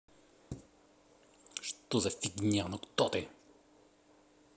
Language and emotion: Russian, angry